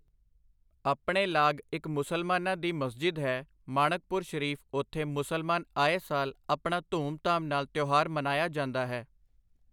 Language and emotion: Punjabi, neutral